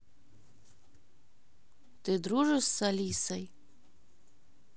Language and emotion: Russian, neutral